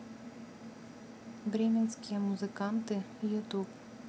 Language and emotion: Russian, neutral